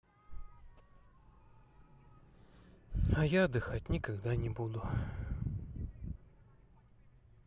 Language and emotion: Russian, sad